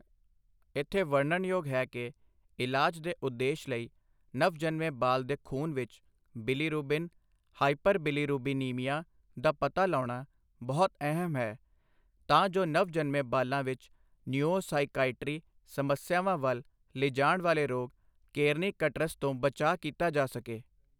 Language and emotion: Punjabi, neutral